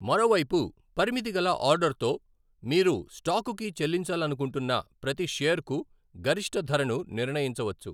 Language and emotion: Telugu, neutral